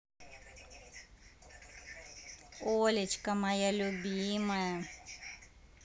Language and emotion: Russian, positive